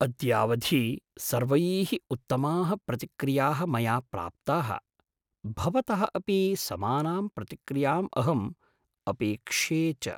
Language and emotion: Sanskrit, surprised